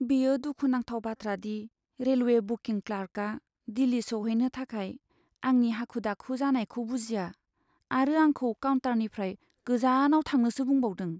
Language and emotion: Bodo, sad